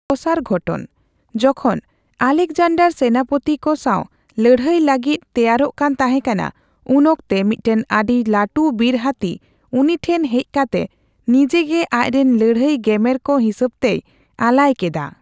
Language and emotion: Santali, neutral